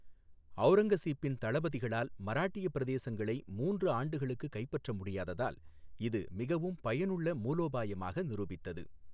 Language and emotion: Tamil, neutral